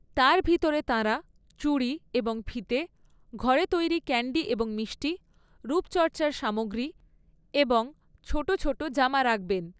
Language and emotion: Bengali, neutral